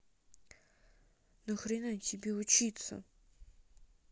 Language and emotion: Russian, angry